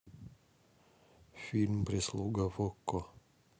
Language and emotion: Russian, neutral